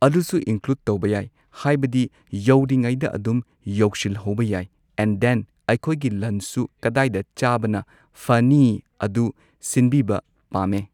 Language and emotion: Manipuri, neutral